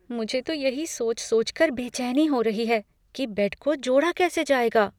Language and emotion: Hindi, fearful